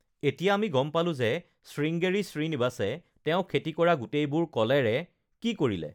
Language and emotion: Assamese, neutral